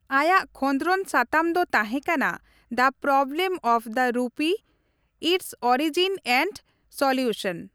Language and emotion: Santali, neutral